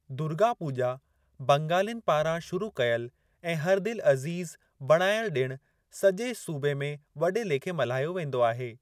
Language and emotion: Sindhi, neutral